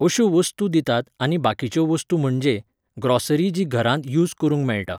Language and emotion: Goan Konkani, neutral